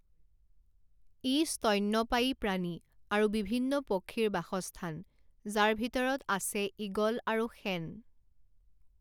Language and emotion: Assamese, neutral